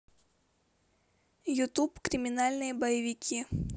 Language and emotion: Russian, neutral